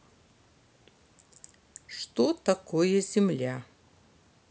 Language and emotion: Russian, neutral